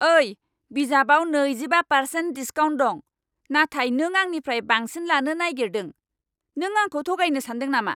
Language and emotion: Bodo, angry